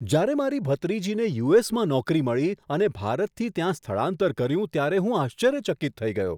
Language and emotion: Gujarati, surprised